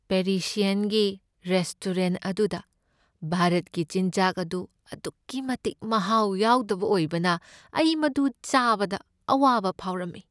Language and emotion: Manipuri, sad